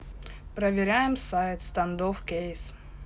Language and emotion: Russian, neutral